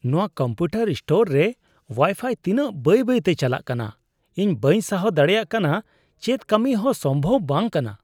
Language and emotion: Santali, disgusted